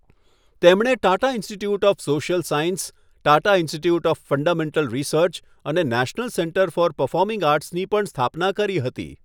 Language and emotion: Gujarati, neutral